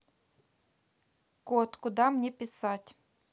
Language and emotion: Russian, neutral